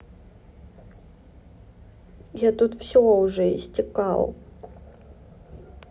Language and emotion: Russian, neutral